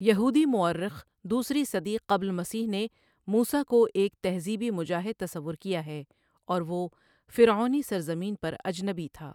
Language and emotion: Urdu, neutral